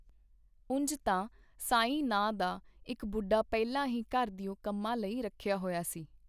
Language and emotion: Punjabi, neutral